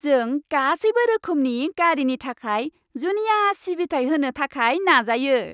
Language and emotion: Bodo, happy